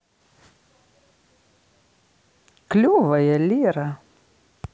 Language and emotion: Russian, positive